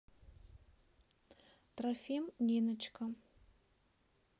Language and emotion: Russian, neutral